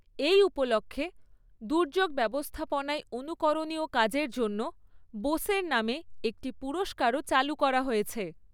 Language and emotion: Bengali, neutral